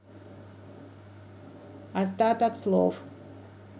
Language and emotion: Russian, neutral